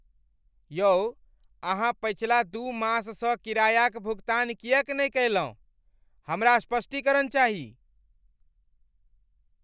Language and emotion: Maithili, angry